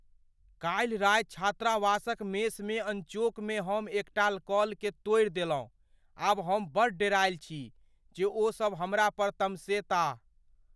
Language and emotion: Maithili, fearful